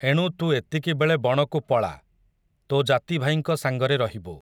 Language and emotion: Odia, neutral